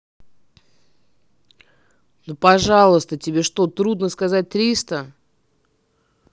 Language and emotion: Russian, angry